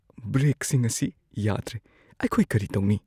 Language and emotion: Manipuri, fearful